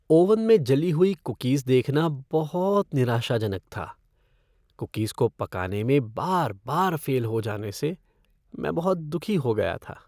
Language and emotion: Hindi, sad